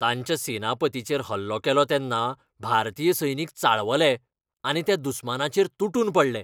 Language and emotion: Goan Konkani, angry